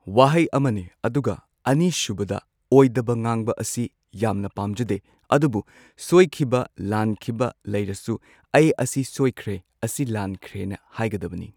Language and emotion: Manipuri, neutral